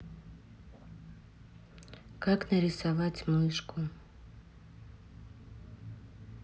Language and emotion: Russian, neutral